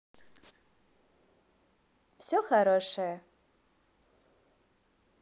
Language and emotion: Russian, positive